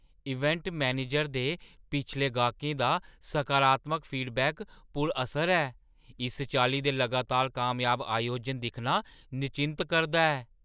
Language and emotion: Dogri, surprised